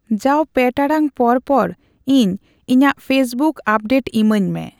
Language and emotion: Santali, neutral